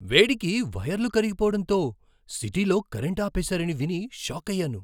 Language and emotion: Telugu, surprised